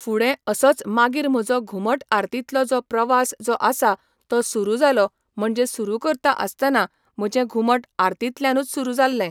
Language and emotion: Goan Konkani, neutral